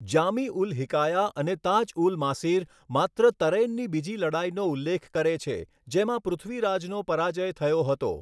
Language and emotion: Gujarati, neutral